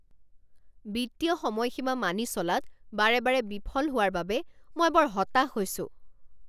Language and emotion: Assamese, angry